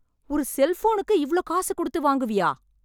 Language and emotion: Tamil, angry